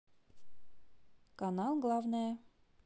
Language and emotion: Russian, positive